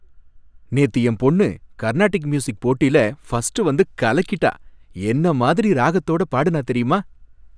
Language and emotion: Tamil, happy